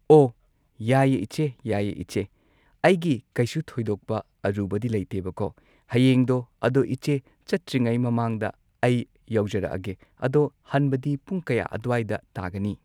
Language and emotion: Manipuri, neutral